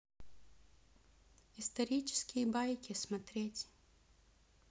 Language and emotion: Russian, neutral